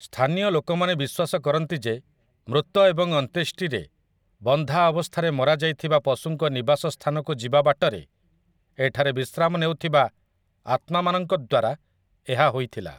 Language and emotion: Odia, neutral